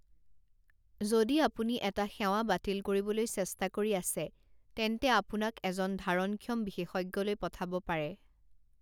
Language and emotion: Assamese, neutral